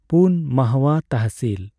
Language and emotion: Santali, neutral